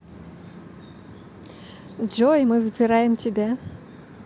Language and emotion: Russian, positive